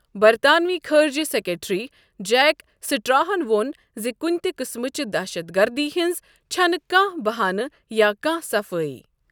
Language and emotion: Kashmiri, neutral